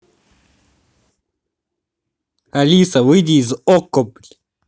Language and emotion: Russian, angry